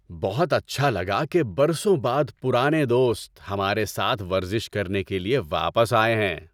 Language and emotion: Urdu, happy